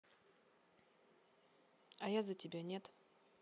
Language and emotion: Russian, neutral